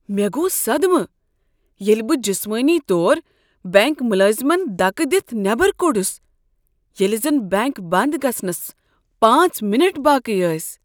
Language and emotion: Kashmiri, surprised